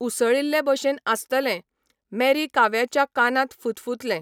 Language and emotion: Goan Konkani, neutral